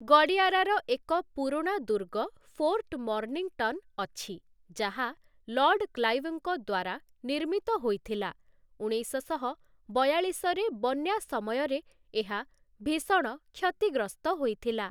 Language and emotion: Odia, neutral